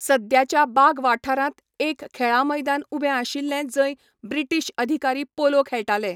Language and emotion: Goan Konkani, neutral